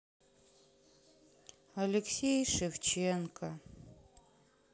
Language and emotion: Russian, sad